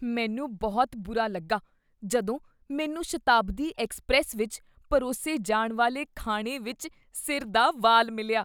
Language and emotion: Punjabi, disgusted